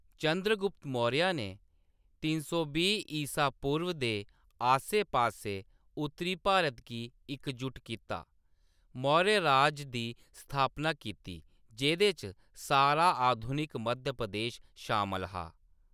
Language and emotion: Dogri, neutral